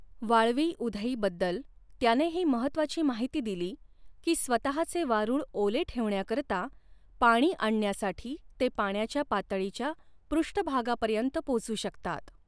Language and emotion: Marathi, neutral